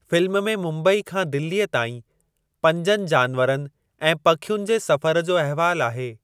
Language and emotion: Sindhi, neutral